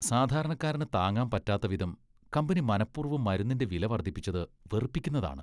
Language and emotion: Malayalam, disgusted